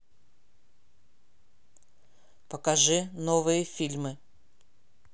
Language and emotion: Russian, neutral